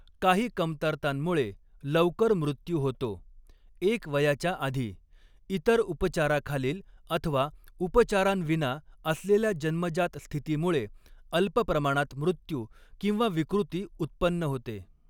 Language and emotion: Marathi, neutral